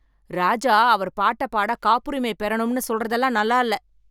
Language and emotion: Tamil, angry